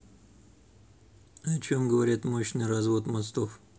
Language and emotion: Russian, neutral